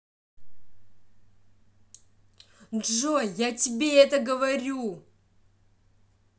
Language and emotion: Russian, angry